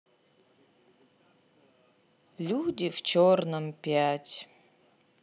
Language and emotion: Russian, sad